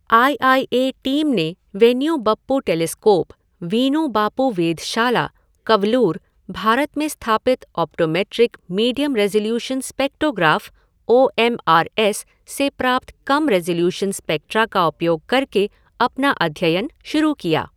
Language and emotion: Hindi, neutral